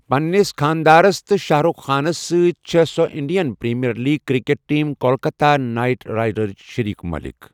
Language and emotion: Kashmiri, neutral